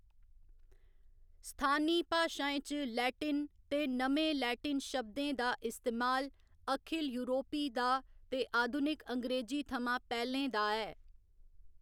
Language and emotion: Dogri, neutral